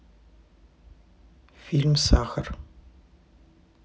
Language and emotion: Russian, neutral